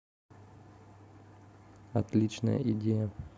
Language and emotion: Russian, neutral